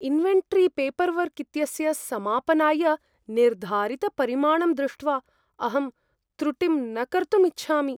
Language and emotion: Sanskrit, fearful